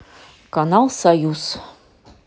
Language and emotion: Russian, neutral